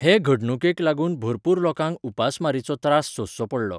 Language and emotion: Goan Konkani, neutral